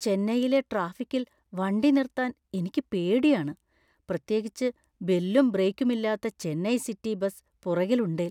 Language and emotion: Malayalam, fearful